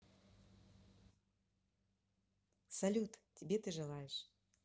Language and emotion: Russian, positive